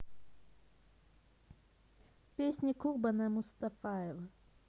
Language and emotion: Russian, neutral